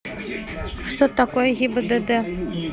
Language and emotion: Russian, neutral